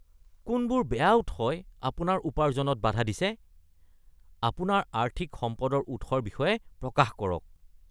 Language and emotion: Assamese, disgusted